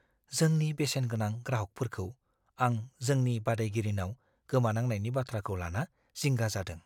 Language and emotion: Bodo, fearful